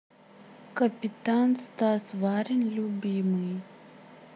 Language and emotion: Russian, neutral